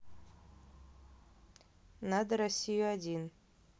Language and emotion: Russian, neutral